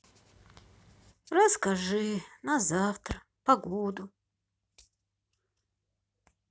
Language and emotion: Russian, sad